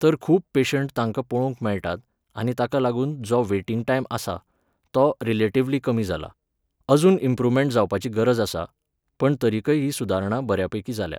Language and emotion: Goan Konkani, neutral